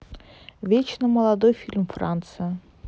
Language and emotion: Russian, neutral